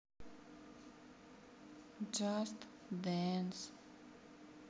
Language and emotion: Russian, sad